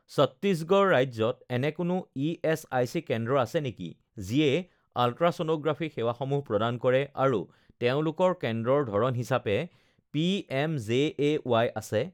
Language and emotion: Assamese, neutral